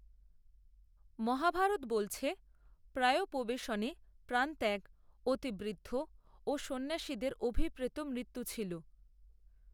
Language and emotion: Bengali, neutral